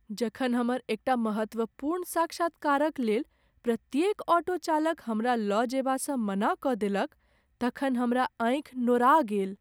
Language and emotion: Maithili, sad